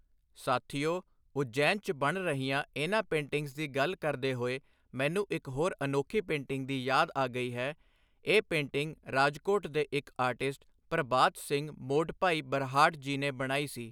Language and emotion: Punjabi, neutral